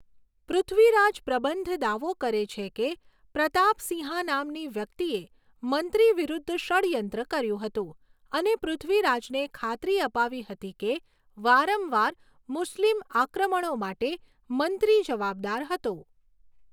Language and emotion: Gujarati, neutral